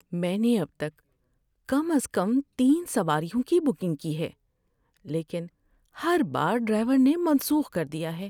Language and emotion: Urdu, sad